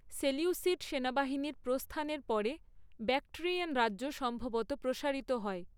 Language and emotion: Bengali, neutral